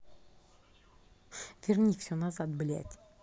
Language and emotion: Russian, angry